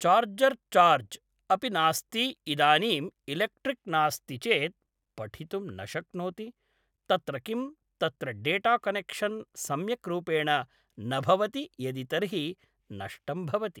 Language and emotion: Sanskrit, neutral